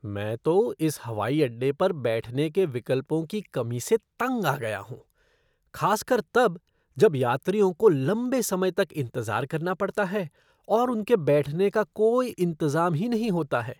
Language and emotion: Hindi, disgusted